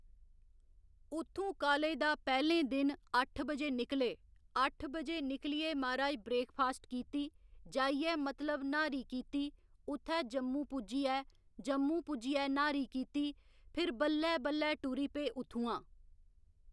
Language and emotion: Dogri, neutral